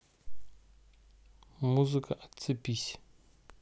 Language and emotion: Russian, neutral